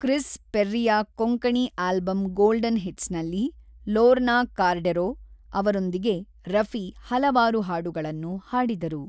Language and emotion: Kannada, neutral